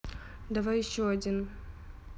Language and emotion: Russian, neutral